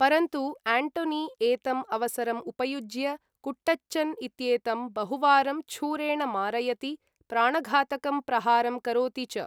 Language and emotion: Sanskrit, neutral